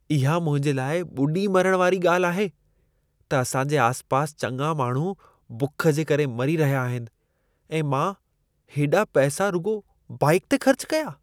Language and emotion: Sindhi, disgusted